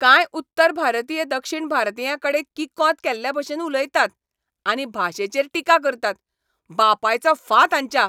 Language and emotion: Goan Konkani, angry